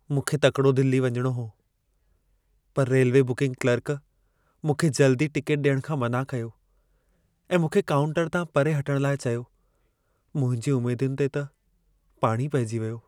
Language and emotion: Sindhi, sad